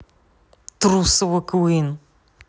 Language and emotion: Russian, angry